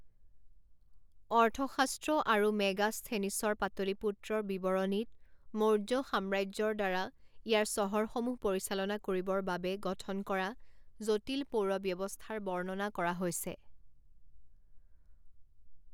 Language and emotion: Assamese, neutral